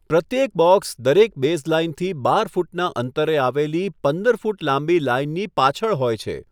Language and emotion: Gujarati, neutral